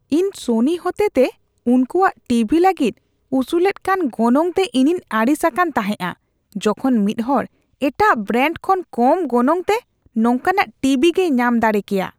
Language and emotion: Santali, disgusted